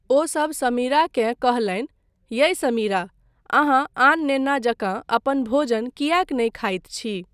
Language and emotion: Maithili, neutral